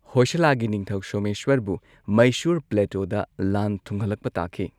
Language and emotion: Manipuri, neutral